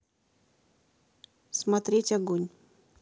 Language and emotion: Russian, neutral